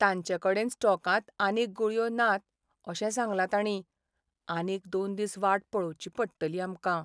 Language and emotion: Goan Konkani, sad